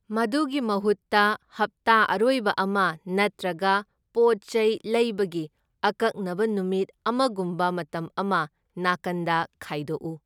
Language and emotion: Manipuri, neutral